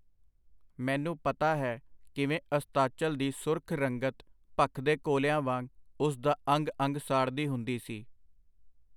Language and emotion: Punjabi, neutral